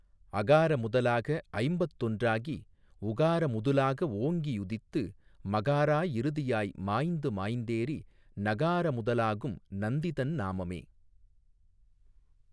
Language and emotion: Tamil, neutral